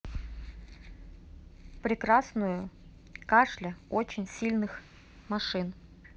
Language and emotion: Russian, neutral